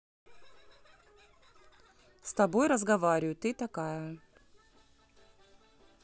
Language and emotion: Russian, neutral